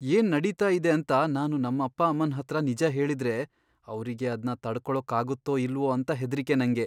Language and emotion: Kannada, fearful